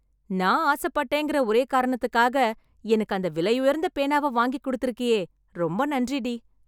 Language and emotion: Tamil, happy